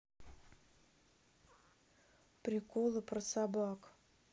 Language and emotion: Russian, neutral